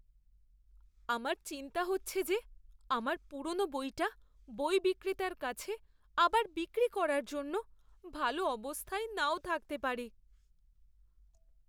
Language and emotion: Bengali, fearful